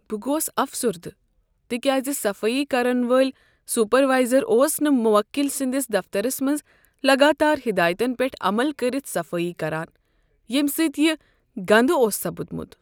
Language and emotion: Kashmiri, sad